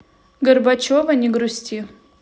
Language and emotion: Russian, neutral